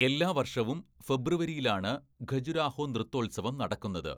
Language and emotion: Malayalam, neutral